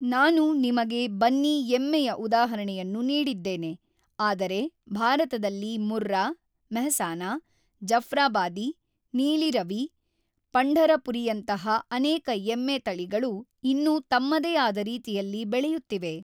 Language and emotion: Kannada, neutral